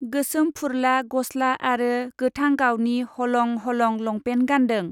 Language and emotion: Bodo, neutral